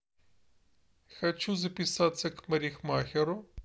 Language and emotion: Russian, neutral